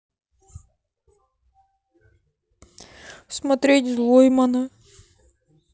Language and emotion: Russian, sad